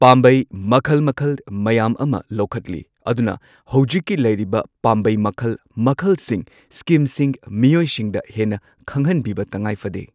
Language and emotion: Manipuri, neutral